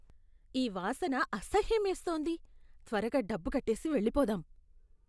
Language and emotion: Telugu, disgusted